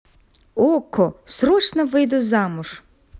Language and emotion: Russian, positive